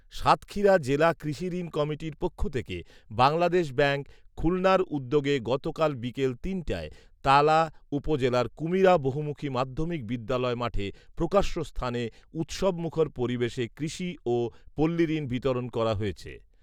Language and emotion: Bengali, neutral